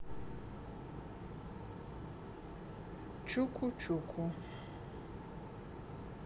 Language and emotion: Russian, neutral